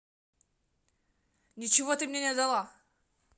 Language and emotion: Russian, neutral